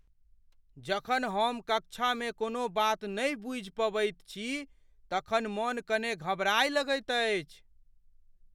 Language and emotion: Maithili, fearful